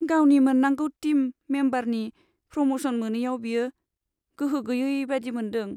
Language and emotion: Bodo, sad